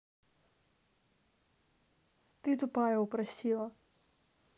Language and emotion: Russian, neutral